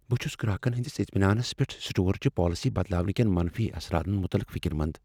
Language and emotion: Kashmiri, fearful